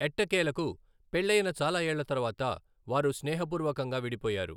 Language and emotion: Telugu, neutral